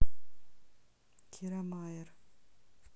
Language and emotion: Russian, neutral